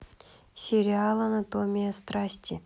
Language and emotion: Russian, neutral